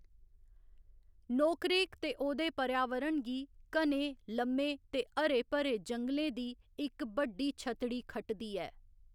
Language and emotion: Dogri, neutral